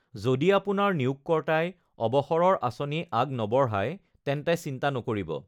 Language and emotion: Assamese, neutral